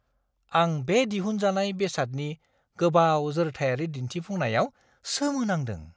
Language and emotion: Bodo, surprised